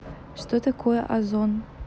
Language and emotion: Russian, neutral